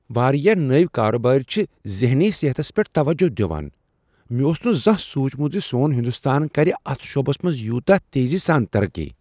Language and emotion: Kashmiri, surprised